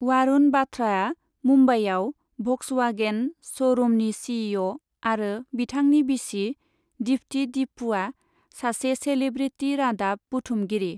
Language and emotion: Bodo, neutral